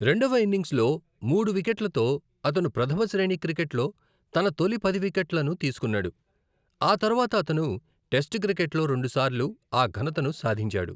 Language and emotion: Telugu, neutral